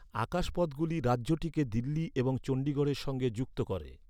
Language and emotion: Bengali, neutral